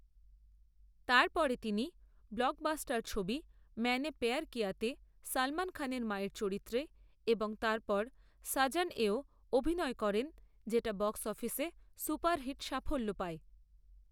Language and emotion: Bengali, neutral